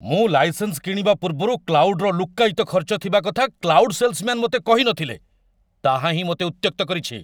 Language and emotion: Odia, angry